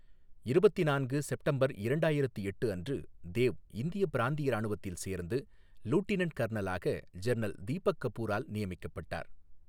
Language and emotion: Tamil, neutral